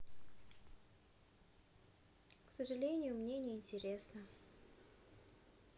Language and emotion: Russian, sad